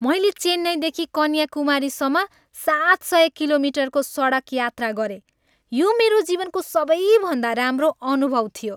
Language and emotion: Nepali, happy